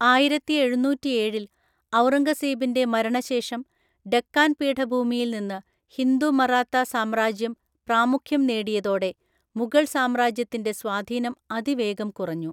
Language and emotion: Malayalam, neutral